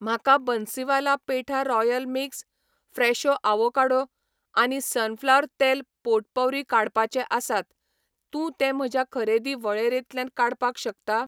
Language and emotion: Goan Konkani, neutral